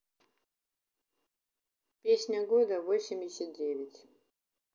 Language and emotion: Russian, neutral